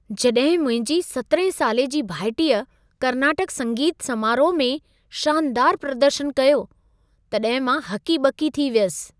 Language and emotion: Sindhi, surprised